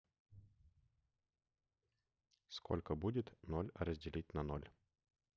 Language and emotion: Russian, neutral